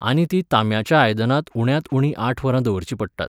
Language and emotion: Goan Konkani, neutral